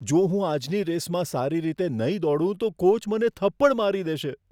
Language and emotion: Gujarati, fearful